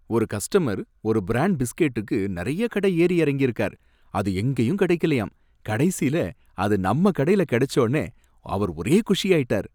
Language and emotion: Tamil, happy